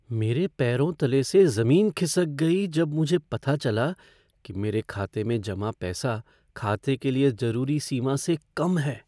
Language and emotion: Hindi, fearful